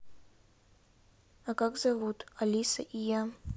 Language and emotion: Russian, neutral